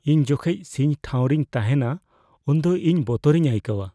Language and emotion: Santali, fearful